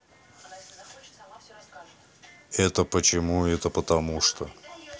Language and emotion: Russian, neutral